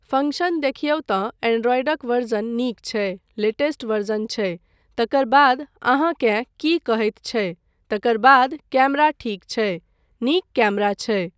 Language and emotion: Maithili, neutral